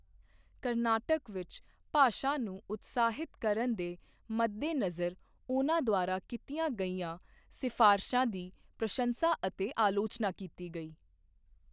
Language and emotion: Punjabi, neutral